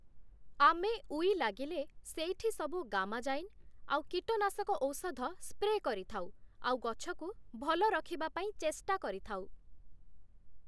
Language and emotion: Odia, neutral